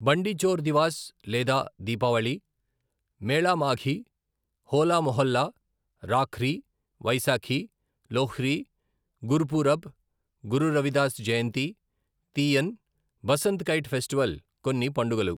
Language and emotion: Telugu, neutral